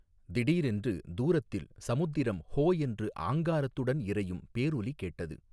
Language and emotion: Tamil, neutral